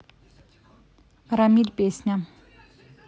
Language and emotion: Russian, neutral